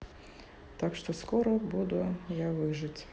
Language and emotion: Russian, neutral